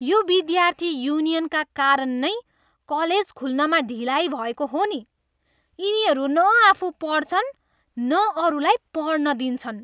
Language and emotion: Nepali, disgusted